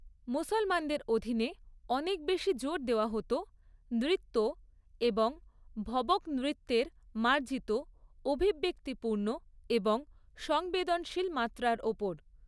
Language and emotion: Bengali, neutral